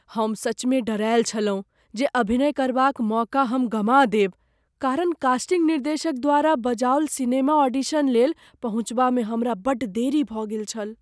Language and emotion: Maithili, fearful